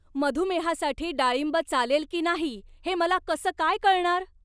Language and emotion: Marathi, angry